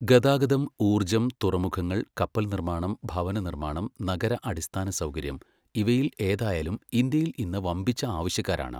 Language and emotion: Malayalam, neutral